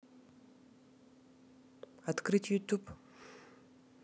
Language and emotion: Russian, neutral